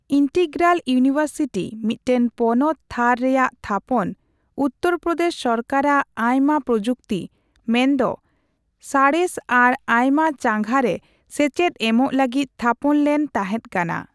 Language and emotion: Santali, neutral